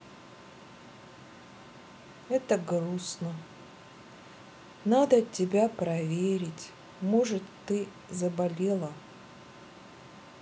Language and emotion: Russian, sad